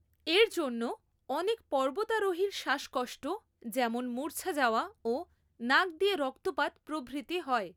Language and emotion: Bengali, neutral